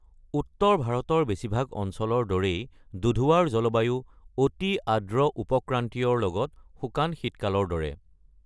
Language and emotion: Assamese, neutral